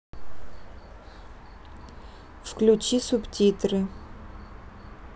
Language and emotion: Russian, neutral